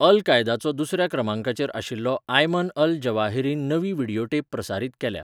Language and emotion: Goan Konkani, neutral